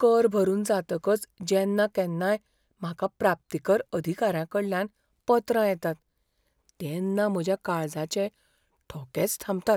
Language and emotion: Goan Konkani, fearful